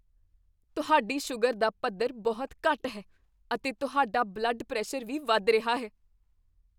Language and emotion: Punjabi, fearful